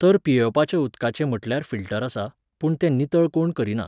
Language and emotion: Goan Konkani, neutral